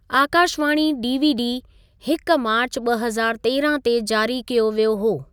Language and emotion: Sindhi, neutral